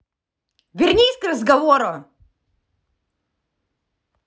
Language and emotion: Russian, angry